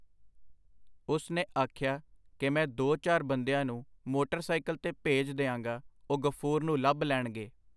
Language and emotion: Punjabi, neutral